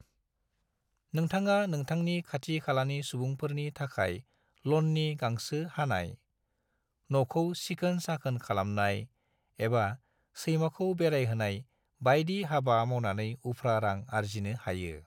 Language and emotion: Bodo, neutral